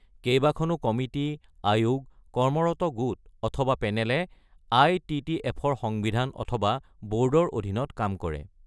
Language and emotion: Assamese, neutral